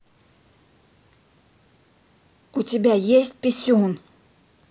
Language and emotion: Russian, neutral